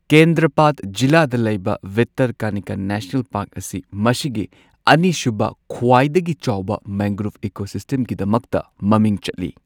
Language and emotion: Manipuri, neutral